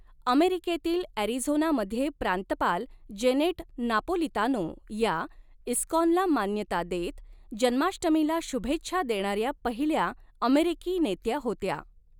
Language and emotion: Marathi, neutral